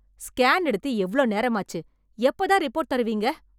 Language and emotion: Tamil, angry